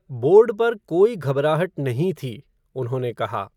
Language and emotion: Hindi, neutral